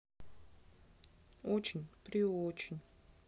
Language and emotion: Russian, sad